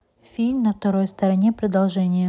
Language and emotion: Russian, neutral